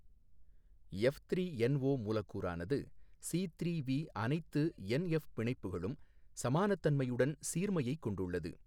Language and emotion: Tamil, neutral